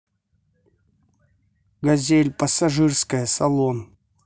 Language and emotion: Russian, neutral